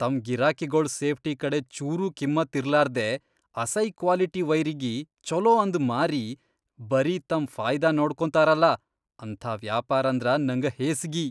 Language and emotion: Kannada, disgusted